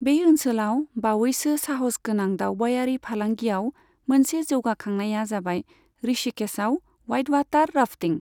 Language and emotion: Bodo, neutral